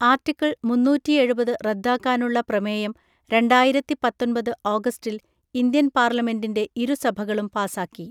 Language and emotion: Malayalam, neutral